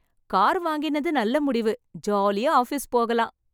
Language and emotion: Tamil, happy